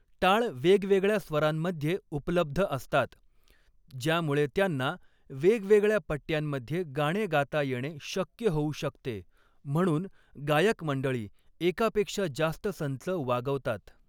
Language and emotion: Marathi, neutral